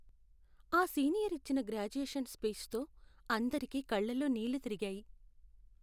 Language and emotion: Telugu, sad